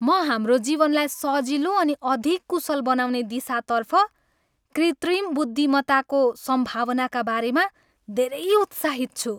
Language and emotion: Nepali, happy